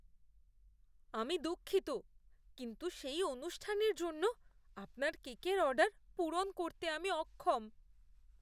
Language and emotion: Bengali, fearful